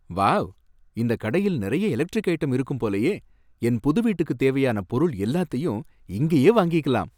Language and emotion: Tamil, happy